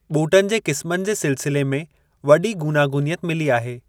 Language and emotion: Sindhi, neutral